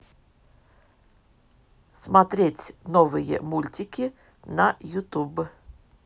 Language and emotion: Russian, neutral